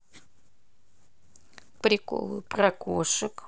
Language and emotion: Russian, neutral